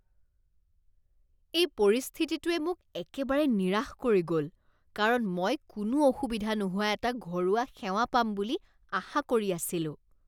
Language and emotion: Assamese, disgusted